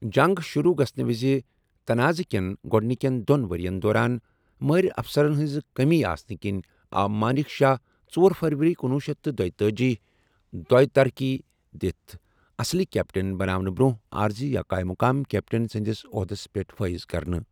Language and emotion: Kashmiri, neutral